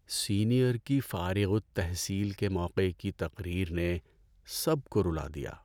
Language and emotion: Urdu, sad